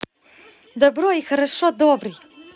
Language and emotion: Russian, positive